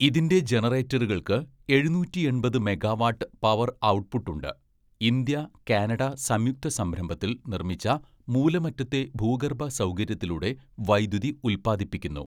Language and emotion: Malayalam, neutral